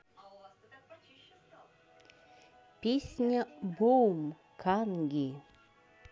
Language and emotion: Russian, neutral